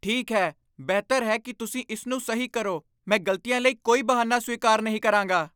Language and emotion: Punjabi, angry